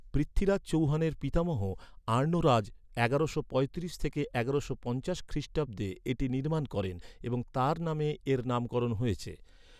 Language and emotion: Bengali, neutral